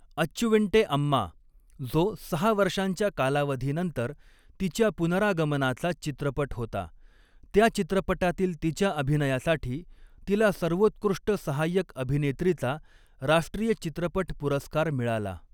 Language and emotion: Marathi, neutral